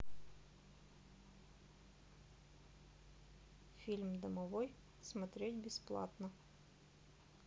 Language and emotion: Russian, neutral